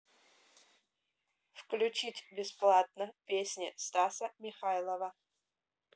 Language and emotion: Russian, neutral